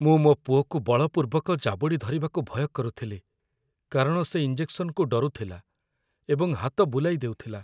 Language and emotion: Odia, fearful